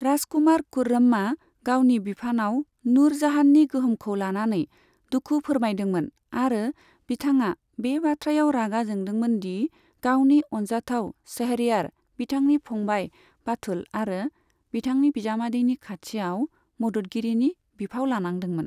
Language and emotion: Bodo, neutral